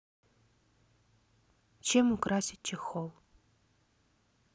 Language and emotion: Russian, neutral